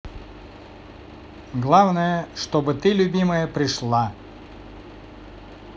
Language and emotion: Russian, positive